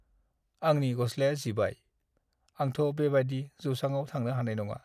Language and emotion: Bodo, sad